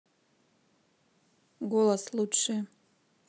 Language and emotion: Russian, neutral